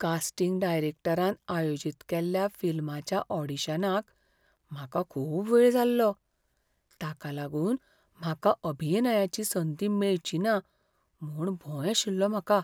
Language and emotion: Goan Konkani, fearful